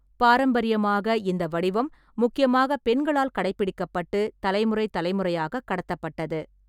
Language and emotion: Tamil, neutral